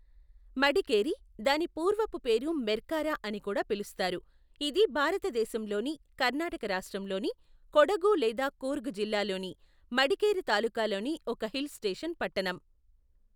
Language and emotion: Telugu, neutral